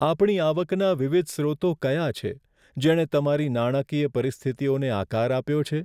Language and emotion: Gujarati, sad